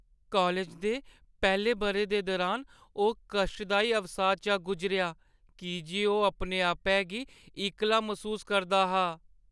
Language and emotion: Dogri, sad